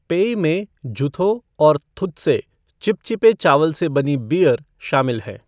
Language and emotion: Hindi, neutral